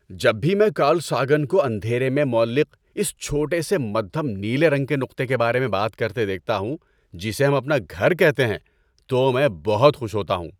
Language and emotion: Urdu, happy